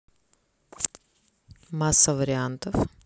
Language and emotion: Russian, neutral